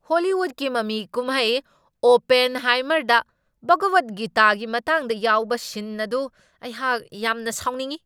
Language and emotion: Manipuri, angry